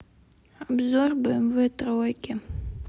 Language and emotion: Russian, sad